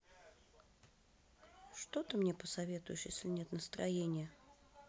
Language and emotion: Russian, sad